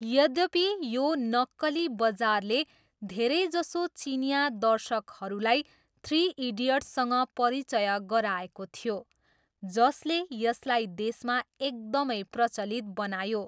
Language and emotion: Nepali, neutral